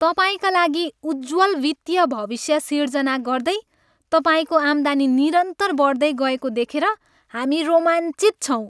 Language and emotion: Nepali, happy